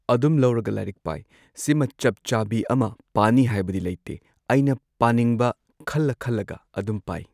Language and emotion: Manipuri, neutral